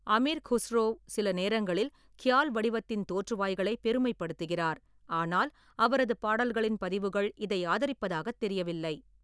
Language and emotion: Tamil, neutral